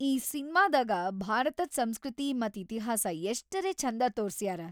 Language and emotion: Kannada, happy